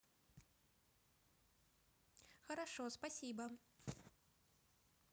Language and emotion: Russian, positive